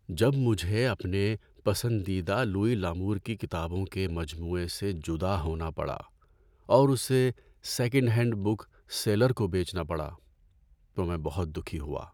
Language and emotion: Urdu, sad